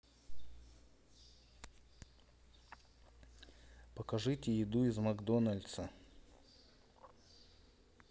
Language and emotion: Russian, neutral